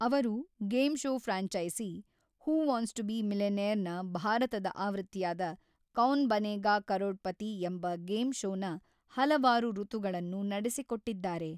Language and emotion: Kannada, neutral